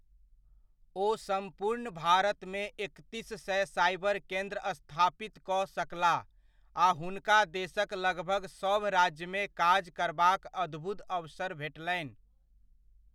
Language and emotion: Maithili, neutral